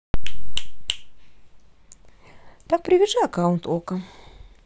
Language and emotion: Russian, positive